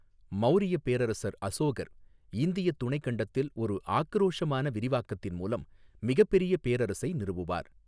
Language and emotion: Tamil, neutral